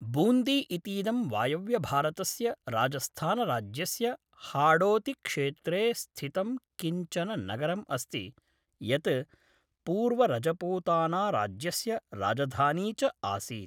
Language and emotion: Sanskrit, neutral